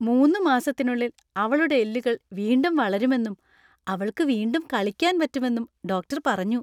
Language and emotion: Malayalam, happy